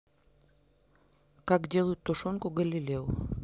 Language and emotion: Russian, neutral